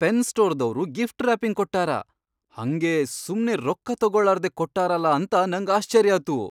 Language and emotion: Kannada, surprised